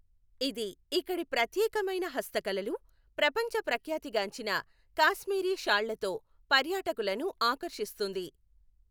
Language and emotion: Telugu, neutral